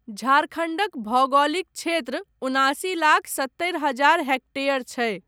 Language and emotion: Maithili, neutral